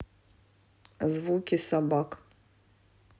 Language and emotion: Russian, neutral